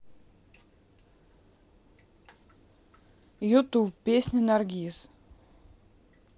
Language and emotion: Russian, neutral